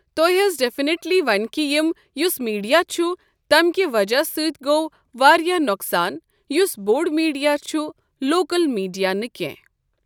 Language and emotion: Kashmiri, neutral